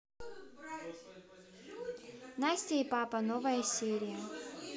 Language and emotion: Russian, neutral